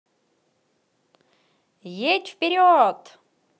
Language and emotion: Russian, positive